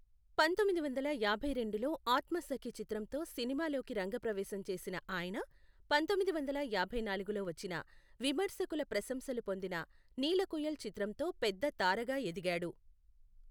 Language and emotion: Telugu, neutral